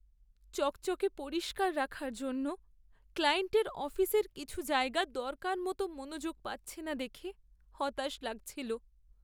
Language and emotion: Bengali, sad